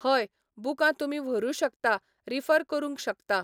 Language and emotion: Goan Konkani, neutral